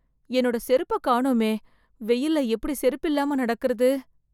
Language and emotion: Tamil, fearful